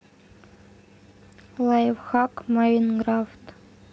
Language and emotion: Russian, neutral